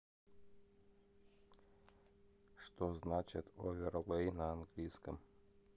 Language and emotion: Russian, neutral